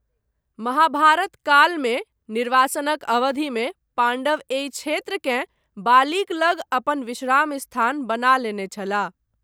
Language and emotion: Maithili, neutral